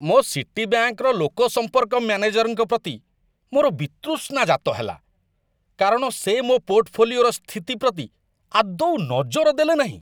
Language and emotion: Odia, disgusted